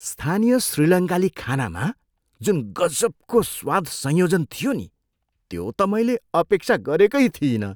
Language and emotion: Nepali, surprised